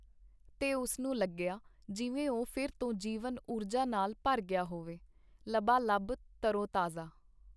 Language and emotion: Punjabi, neutral